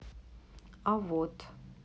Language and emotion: Russian, neutral